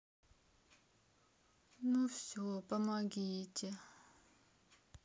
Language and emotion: Russian, sad